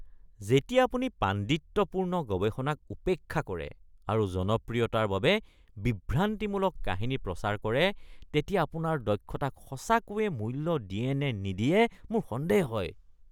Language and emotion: Assamese, disgusted